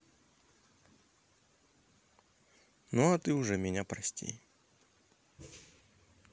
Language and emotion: Russian, neutral